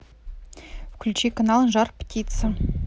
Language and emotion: Russian, neutral